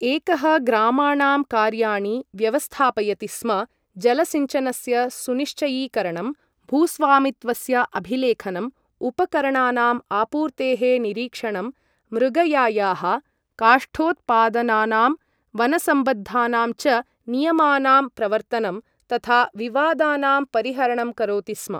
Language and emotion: Sanskrit, neutral